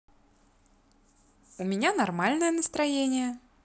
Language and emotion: Russian, positive